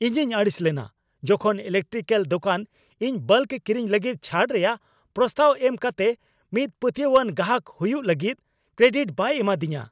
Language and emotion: Santali, angry